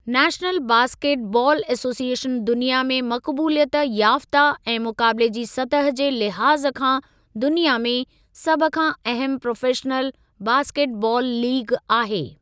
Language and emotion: Sindhi, neutral